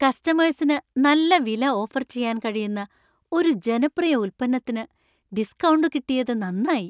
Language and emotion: Malayalam, happy